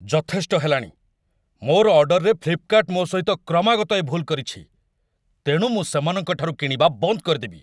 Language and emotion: Odia, angry